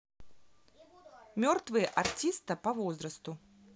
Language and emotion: Russian, neutral